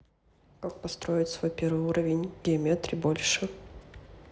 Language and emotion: Russian, neutral